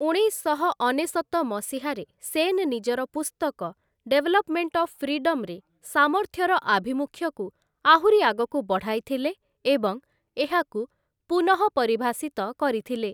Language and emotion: Odia, neutral